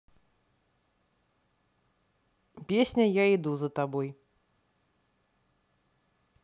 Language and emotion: Russian, neutral